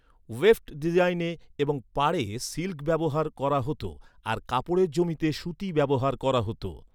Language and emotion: Bengali, neutral